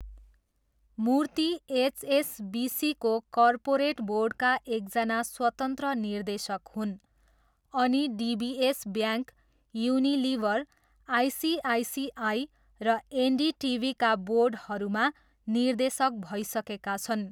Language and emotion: Nepali, neutral